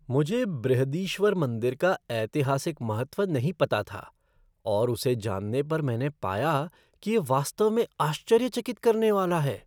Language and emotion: Hindi, surprised